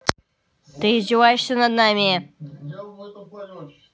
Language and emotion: Russian, angry